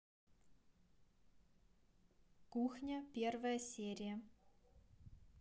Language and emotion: Russian, neutral